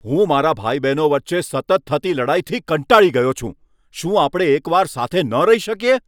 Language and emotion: Gujarati, angry